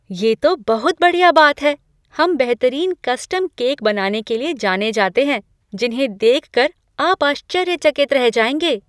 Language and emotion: Hindi, surprised